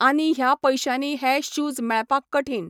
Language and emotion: Goan Konkani, neutral